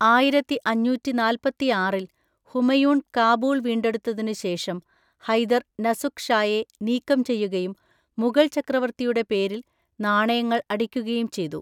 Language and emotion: Malayalam, neutral